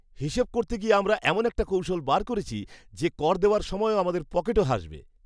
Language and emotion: Bengali, happy